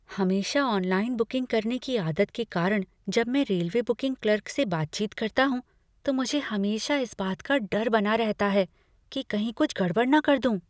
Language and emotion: Hindi, fearful